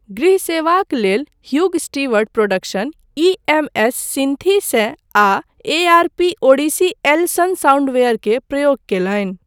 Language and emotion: Maithili, neutral